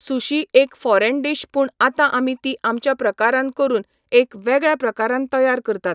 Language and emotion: Goan Konkani, neutral